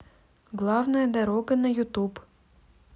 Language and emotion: Russian, neutral